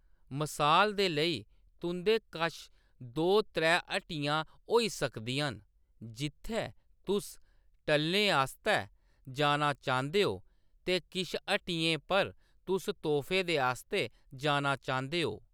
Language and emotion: Dogri, neutral